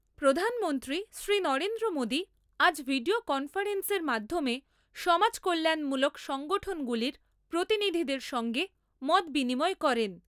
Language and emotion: Bengali, neutral